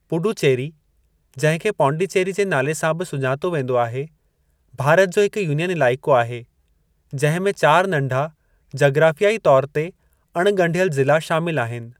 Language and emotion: Sindhi, neutral